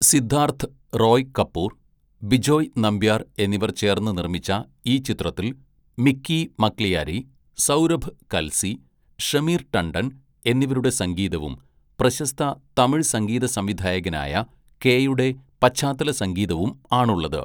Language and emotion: Malayalam, neutral